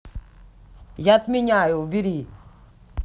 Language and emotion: Russian, angry